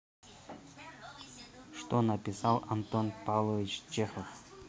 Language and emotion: Russian, neutral